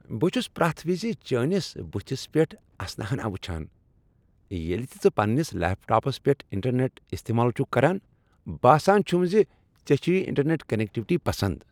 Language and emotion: Kashmiri, happy